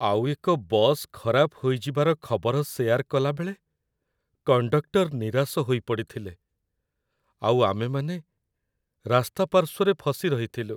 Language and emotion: Odia, sad